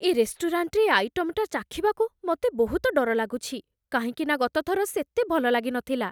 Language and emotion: Odia, fearful